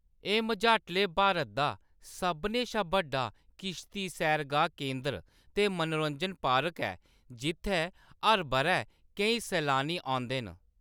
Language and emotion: Dogri, neutral